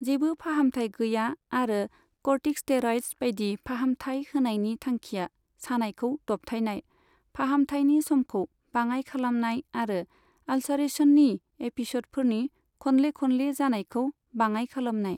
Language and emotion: Bodo, neutral